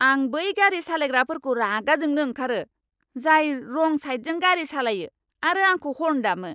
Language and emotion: Bodo, angry